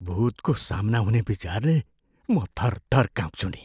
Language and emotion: Nepali, fearful